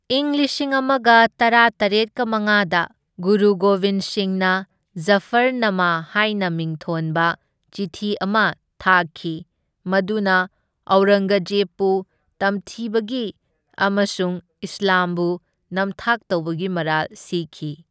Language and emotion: Manipuri, neutral